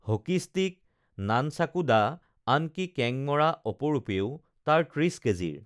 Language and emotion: Assamese, neutral